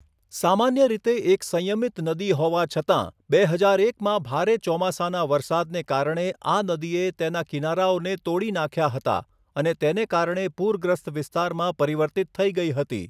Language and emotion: Gujarati, neutral